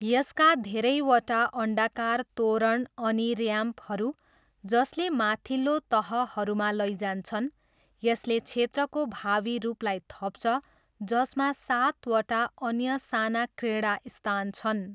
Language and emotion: Nepali, neutral